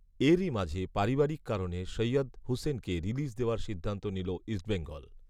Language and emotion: Bengali, neutral